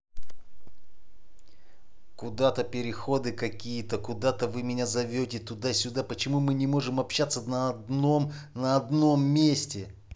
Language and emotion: Russian, angry